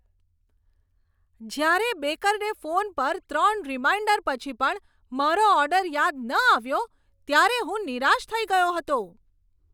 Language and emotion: Gujarati, angry